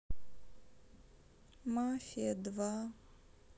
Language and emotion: Russian, sad